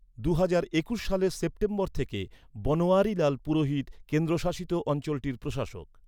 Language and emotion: Bengali, neutral